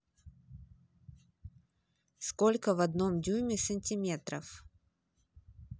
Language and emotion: Russian, neutral